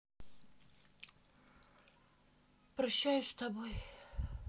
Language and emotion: Russian, sad